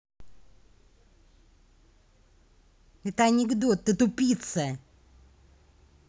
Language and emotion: Russian, angry